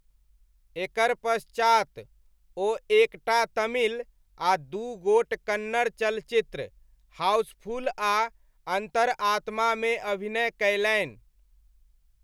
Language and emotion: Maithili, neutral